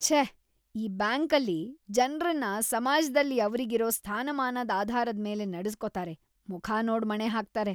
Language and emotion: Kannada, disgusted